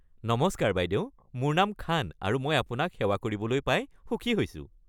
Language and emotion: Assamese, happy